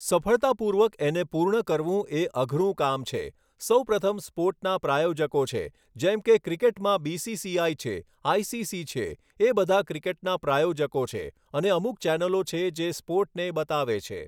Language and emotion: Gujarati, neutral